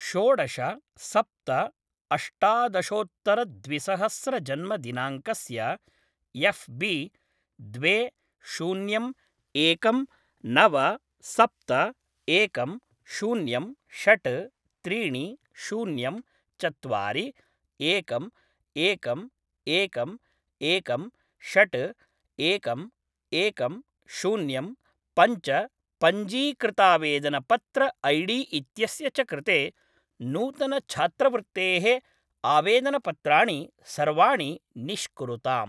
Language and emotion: Sanskrit, neutral